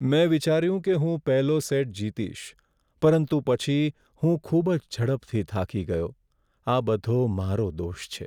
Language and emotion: Gujarati, sad